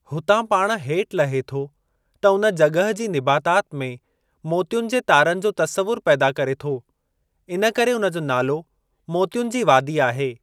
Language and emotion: Sindhi, neutral